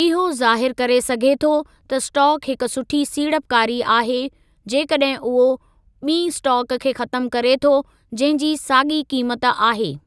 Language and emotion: Sindhi, neutral